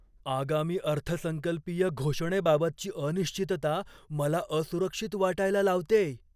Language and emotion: Marathi, fearful